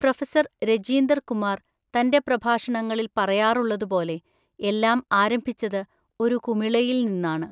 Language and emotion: Malayalam, neutral